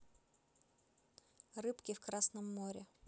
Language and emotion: Russian, neutral